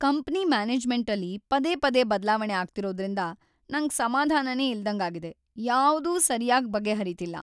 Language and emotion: Kannada, sad